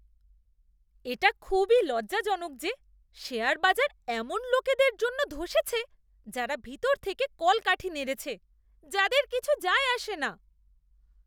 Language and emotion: Bengali, disgusted